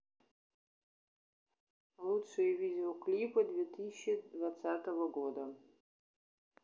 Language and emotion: Russian, neutral